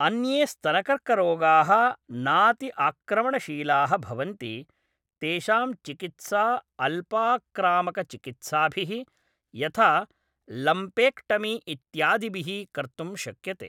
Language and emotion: Sanskrit, neutral